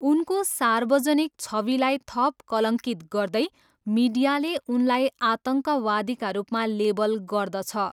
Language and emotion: Nepali, neutral